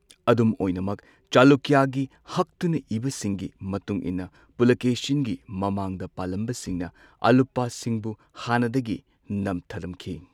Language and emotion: Manipuri, neutral